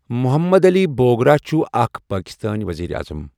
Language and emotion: Kashmiri, neutral